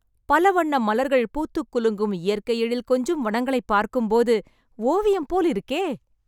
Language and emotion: Tamil, happy